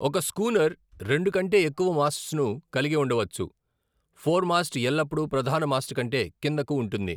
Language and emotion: Telugu, neutral